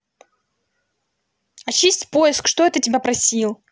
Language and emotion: Russian, angry